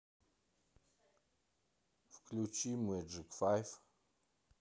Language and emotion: Russian, neutral